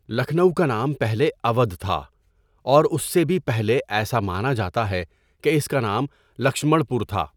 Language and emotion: Urdu, neutral